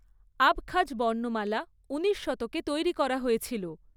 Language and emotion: Bengali, neutral